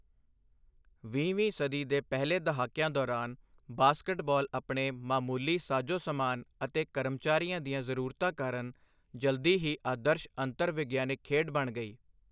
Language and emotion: Punjabi, neutral